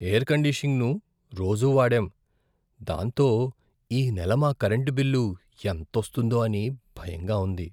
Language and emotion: Telugu, fearful